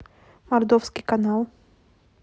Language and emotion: Russian, neutral